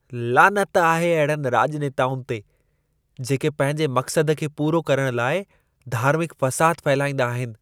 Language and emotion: Sindhi, disgusted